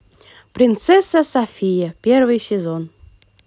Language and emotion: Russian, positive